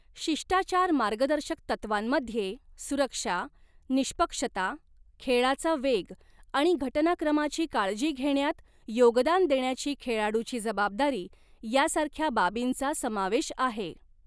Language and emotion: Marathi, neutral